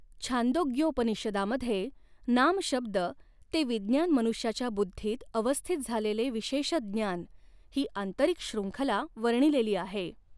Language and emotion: Marathi, neutral